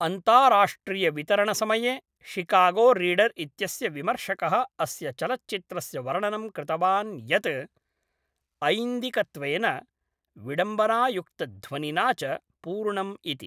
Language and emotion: Sanskrit, neutral